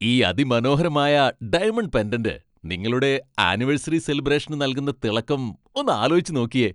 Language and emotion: Malayalam, happy